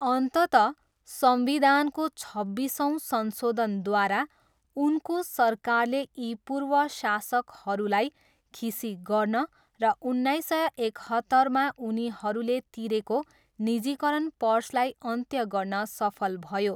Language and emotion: Nepali, neutral